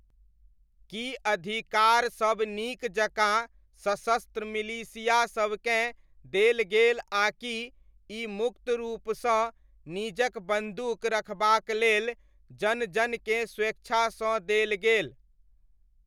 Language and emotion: Maithili, neutral